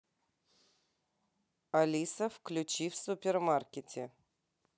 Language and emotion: Russian, neutral